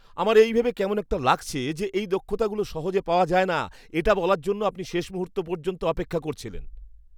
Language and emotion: Bengali, disgusted